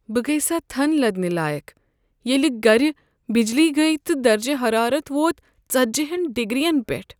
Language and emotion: Kashmiri, sad